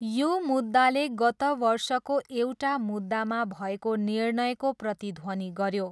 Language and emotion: Nepali, neutral